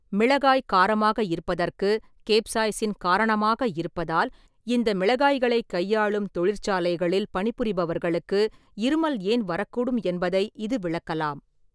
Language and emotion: Tamil, neutral